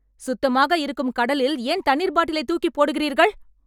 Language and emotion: Tamil, angry